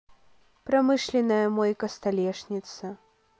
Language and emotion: Russian, neutral